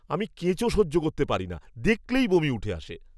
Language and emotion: Bengali, disgusted